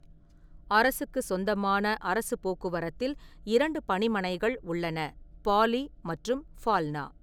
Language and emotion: Tamil, neutral